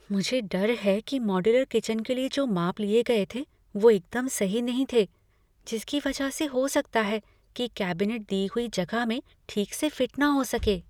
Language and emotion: Hindi, fearful